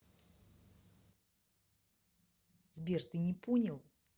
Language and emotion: Russian, angry